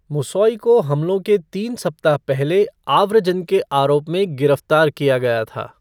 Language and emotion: Hindi, neutral